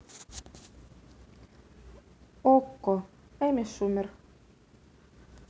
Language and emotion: Russian, neutral